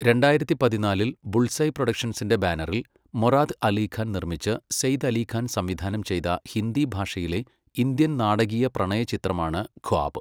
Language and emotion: Malayalam, neutral